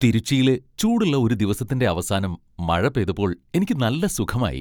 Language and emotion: Malayalam, happy